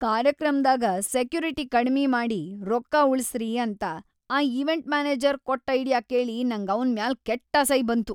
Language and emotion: Kannada, disgusted